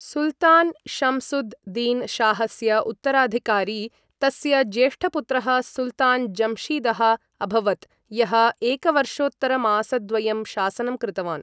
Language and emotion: Sanskrit, neutral